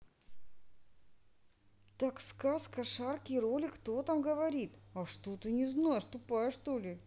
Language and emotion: Russian, angry